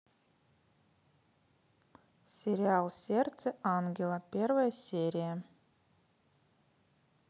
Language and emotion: Russian, neutral